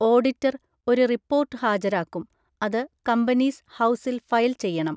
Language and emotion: Malayalam, neutral